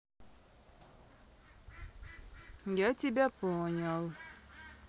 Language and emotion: Russian, neutral